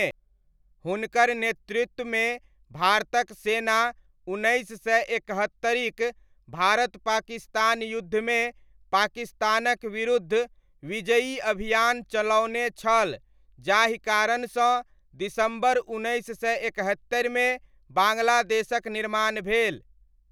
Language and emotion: Maithili, neutral